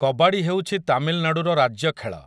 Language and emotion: Odia, neutral